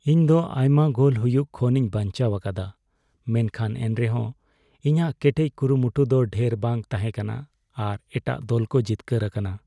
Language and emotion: Santali, sad